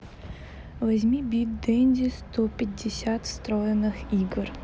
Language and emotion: Russian, neutral